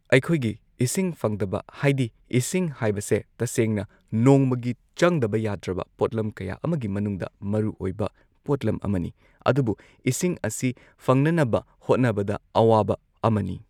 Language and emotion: Manipuri, neutral